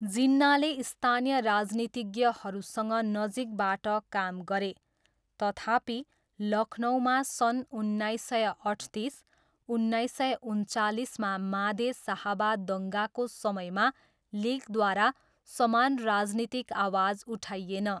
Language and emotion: Nepali, neutral